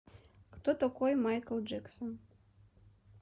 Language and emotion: Russian, neutral